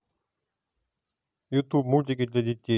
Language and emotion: Russian, neutral